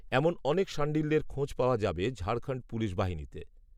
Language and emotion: Bengali, neutral